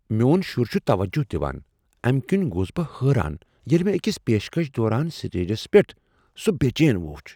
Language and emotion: Kashmiri, surprised